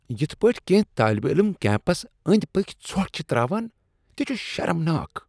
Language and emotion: Kashmiri, disgusted